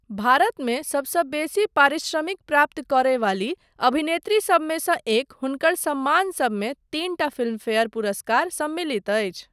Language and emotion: Maithili, neutral